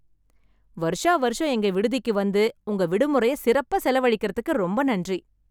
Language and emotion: Tamil, happy